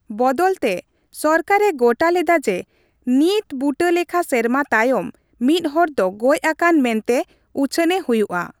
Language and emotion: Santali, neutral